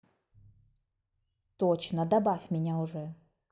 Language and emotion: Russian, angry